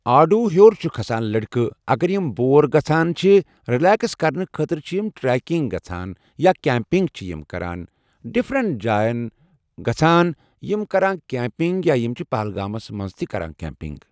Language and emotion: Kashmiri, neutral